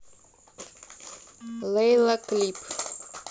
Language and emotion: Russian, neutral